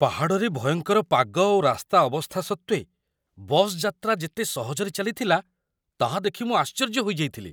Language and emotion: Odia, surprised